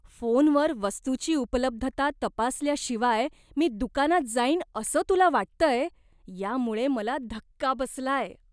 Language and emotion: Marathi, disgusted